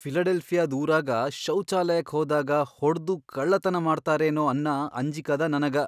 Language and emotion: Kannada, fearful